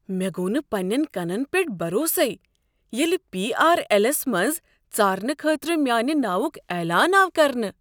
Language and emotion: Kashmiri, surprised